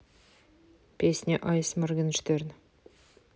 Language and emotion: Russian, neutral